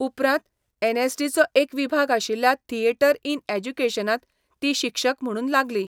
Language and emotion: Goan Konkani, neutral